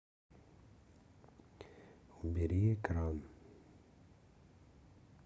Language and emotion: Russian, neutral